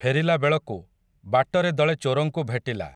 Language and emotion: Odia, neutral